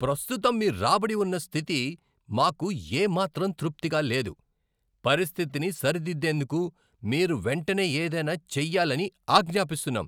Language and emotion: Telugu, angry